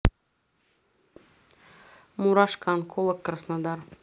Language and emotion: Russian, neutral